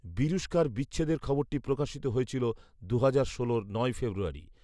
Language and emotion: Bengali, neutral